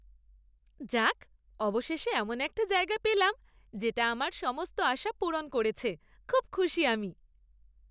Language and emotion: Bengali, happy